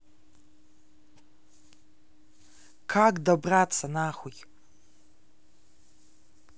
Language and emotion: Russian, neutral